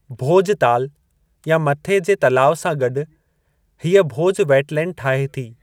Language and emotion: Sindhi, neutral